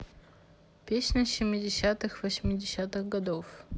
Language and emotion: Russian, neutral